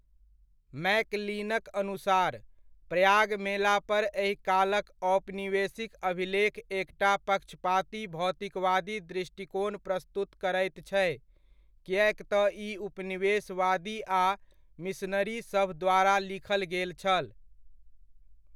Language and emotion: Maithili, neutral